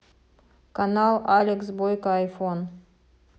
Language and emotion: Russian, neutral